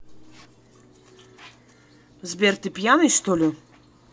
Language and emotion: Russian, angry